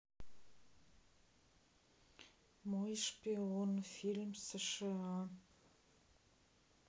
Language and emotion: Russian, neutral